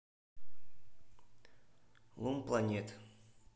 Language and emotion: Russian, neutral